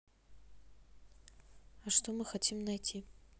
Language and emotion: Russian, neutral